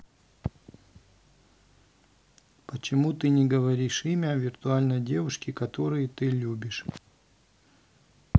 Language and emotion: Russian, neutral